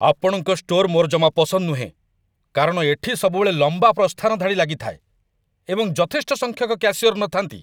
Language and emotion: Odia, angry